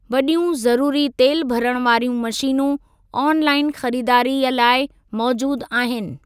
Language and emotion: Sindhi, neutral